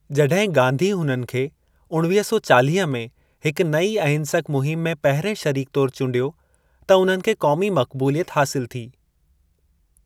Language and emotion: Sindhi, neutral